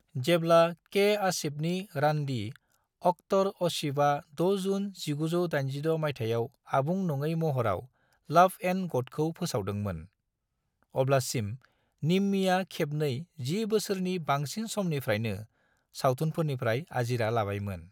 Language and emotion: Bodo, neutral